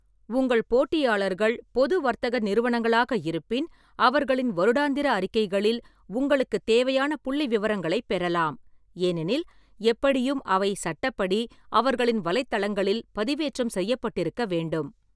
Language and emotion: Tamil, neutral